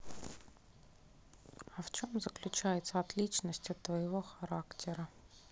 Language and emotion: Russian, neutral